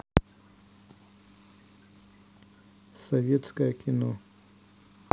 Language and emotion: Russian, neutral